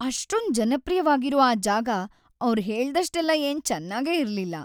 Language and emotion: Kannada, sad